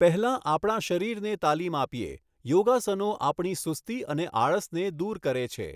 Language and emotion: Gujarati, neutral